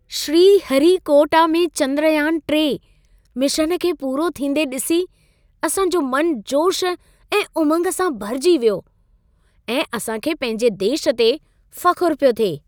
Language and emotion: Sindhi, happy